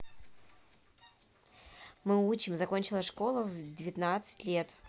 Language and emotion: Russian, neutral